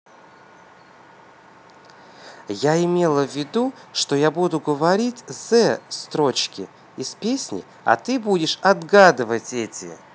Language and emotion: Russian, neutral